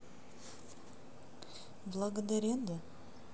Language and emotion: Russian, neutral